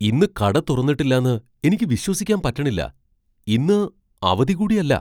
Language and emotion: Malayalam, surprised